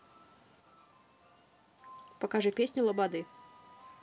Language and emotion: Russian, neutral